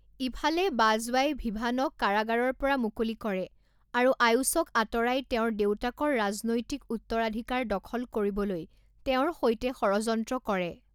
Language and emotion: Assamese, neutral